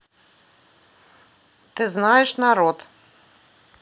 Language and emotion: Russian, neutral